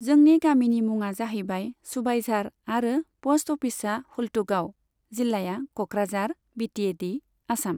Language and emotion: Bodo, neutral